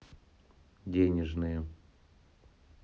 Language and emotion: Russian, neutral